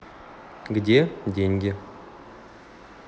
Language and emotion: Russian, neutral